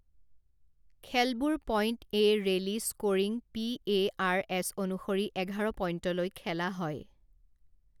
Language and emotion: Assamese, neutral